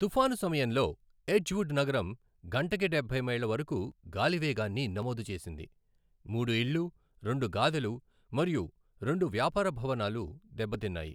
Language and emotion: Telugu, neutral